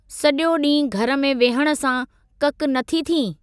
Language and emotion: Sindhi, neutral